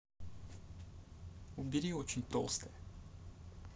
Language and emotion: Russian, neutral